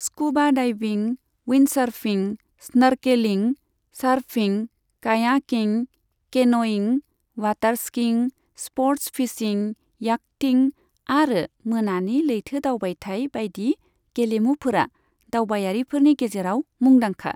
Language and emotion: Bodo, neutral